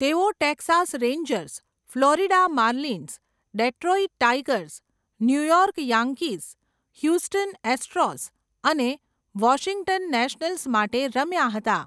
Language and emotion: Gujarati, neutral